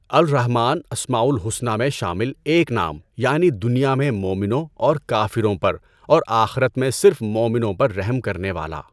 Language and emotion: Urdu, neutral